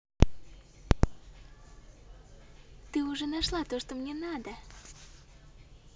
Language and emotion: Russian, positive